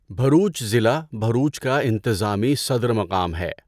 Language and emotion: Urdu, neutral